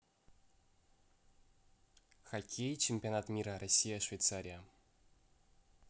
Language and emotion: Russian, neutral